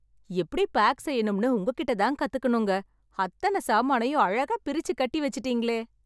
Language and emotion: Tamil, happy